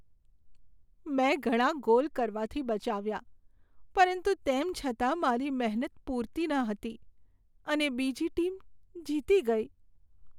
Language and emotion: Gujarati, sad